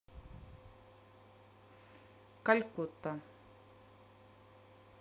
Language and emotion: Russian, neutral